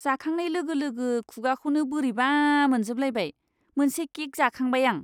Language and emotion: Bodo, disgusted